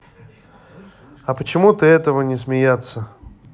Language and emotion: Russian, neutral